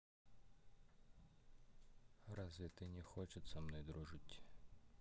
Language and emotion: Russian, neutral